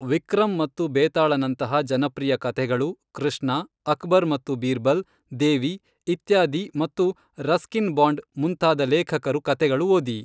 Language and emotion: Kannada, neutral